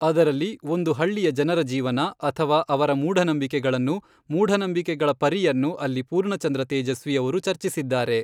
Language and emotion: Kannada, neutral